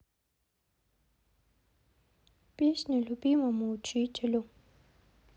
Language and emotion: Russian, sad